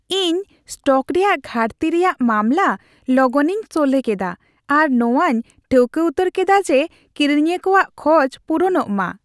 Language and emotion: Santali, happy